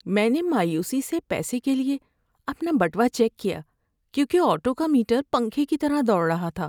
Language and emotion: Urdu, sad